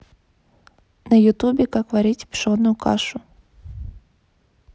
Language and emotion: Russian, neutral